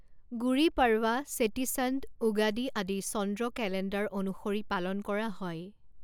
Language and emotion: Assamese, neutral